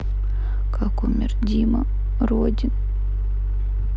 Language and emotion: Russian, sad